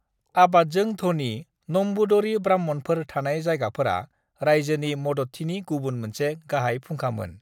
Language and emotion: Bodo, neutral